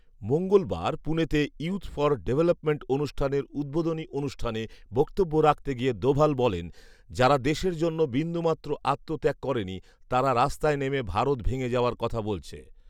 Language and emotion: Bengali, neutral